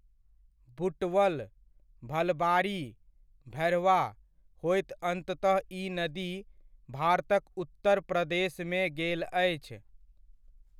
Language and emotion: Maithili, neutral